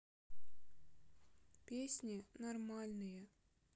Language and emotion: Russian, sad